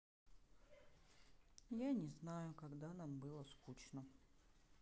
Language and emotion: Russian, sad